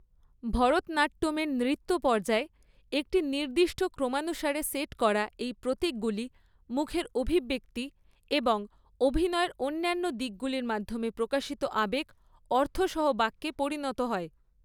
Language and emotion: Bengali, neutral